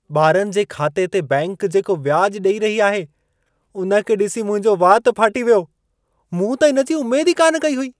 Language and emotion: Sindhi, surprised